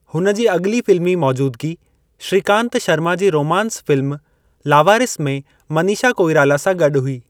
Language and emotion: Sindhi, neutral